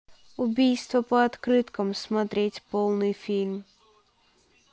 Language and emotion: Russian, neutral